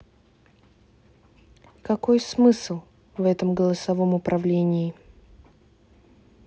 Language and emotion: Russian, neutral